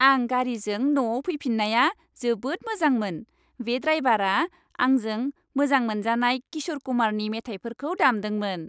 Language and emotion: Bodo, happy